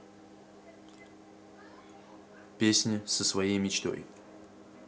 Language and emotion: Russian, neutral